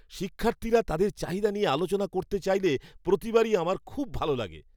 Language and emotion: Bengali, happy